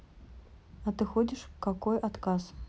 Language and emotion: Russian, neutral